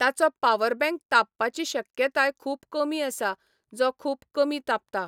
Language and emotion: Goan Konkani, neutral